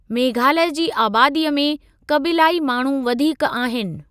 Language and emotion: Sindhi, neutral